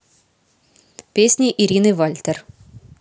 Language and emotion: Russian, neutral